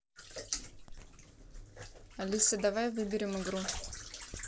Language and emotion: Russian, neutral